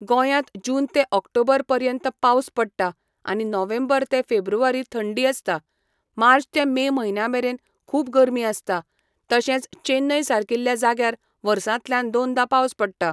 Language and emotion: Goan Konkani, neutral